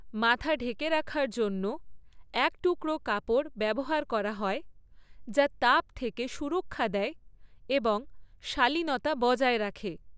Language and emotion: Bengali, neutral